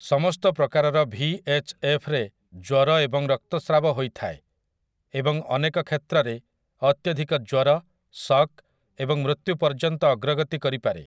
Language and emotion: Odia, neutral